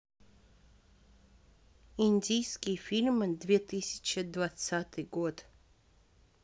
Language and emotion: Russian, neutral